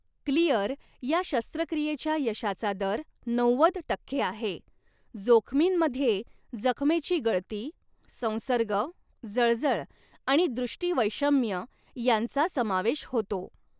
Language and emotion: Marathi, neutral